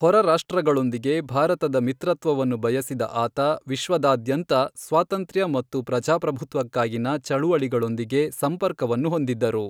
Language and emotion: Kannada, neutral